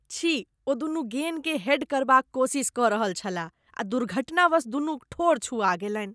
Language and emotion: Maithili, disgusted